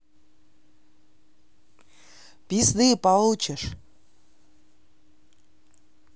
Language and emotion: Russian, neutral